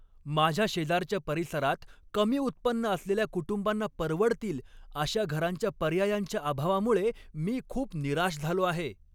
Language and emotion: Marathi, angry